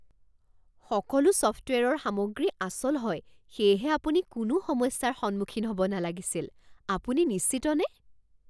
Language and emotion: Assamese, surprised